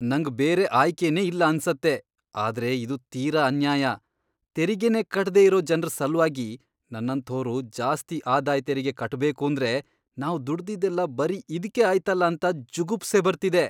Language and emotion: Kannada, disgusted